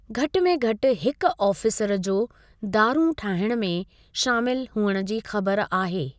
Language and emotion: Sindhi, neutral